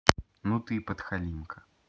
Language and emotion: Russian, neutral